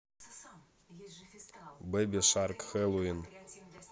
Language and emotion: Russian, neutral